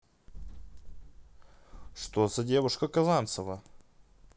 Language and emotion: Russian, neutral